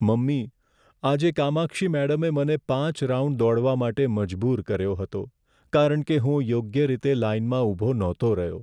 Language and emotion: Gujarati, sad